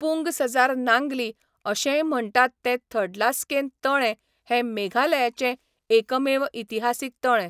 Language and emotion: Goan Konkani, neutral